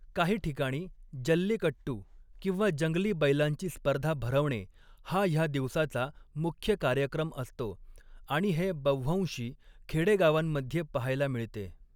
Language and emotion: Marathi, neutral